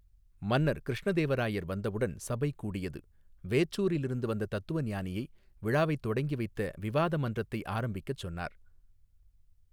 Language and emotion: Tamil, neutral